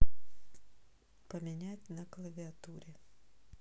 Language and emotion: Russian, neutral